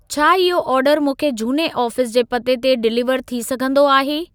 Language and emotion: Sindhi, neutral